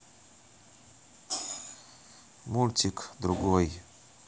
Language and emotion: Russian, neutral